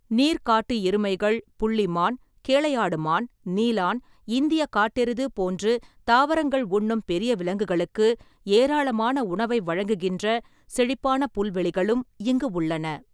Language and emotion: Tamil, neutral